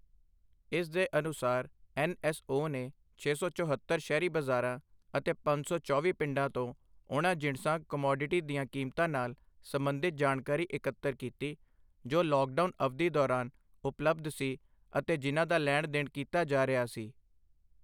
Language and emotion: Punjabi, neutral